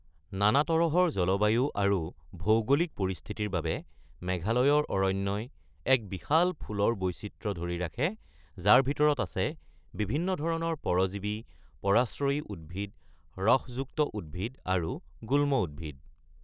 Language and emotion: Assamese, neutral